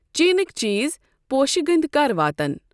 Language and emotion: Kashmiri, neutral